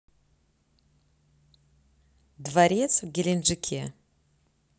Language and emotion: Russian, neutral